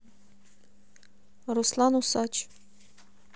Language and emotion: Russian, neutral